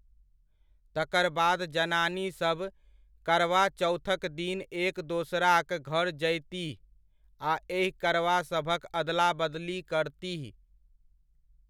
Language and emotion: Maithili, neutral